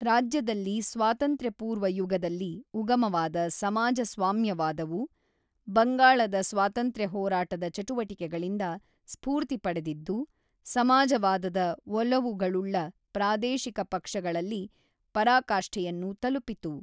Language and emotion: Kannada, neutral